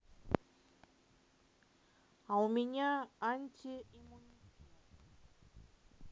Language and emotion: Russian, neutral